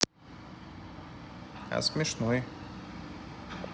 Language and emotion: Russian, neutral